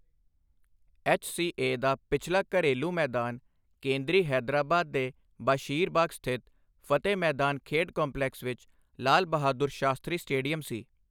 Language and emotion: Punjabi, neutral